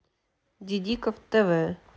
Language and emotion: Russian, neutral